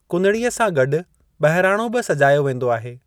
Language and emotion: Sindhi, neutral